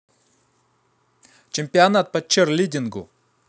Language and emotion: Russian, neutral